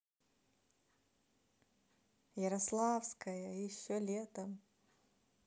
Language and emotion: Russian, positive